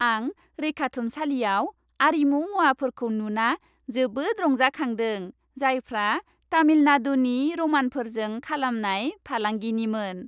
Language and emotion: Bodo, happy